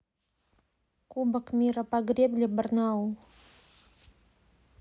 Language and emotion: Russian, neutral